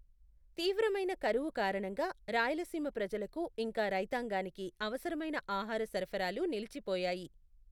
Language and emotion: Telugu, neutral